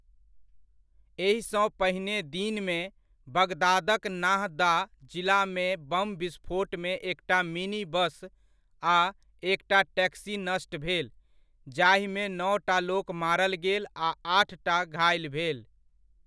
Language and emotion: Maithili, neutral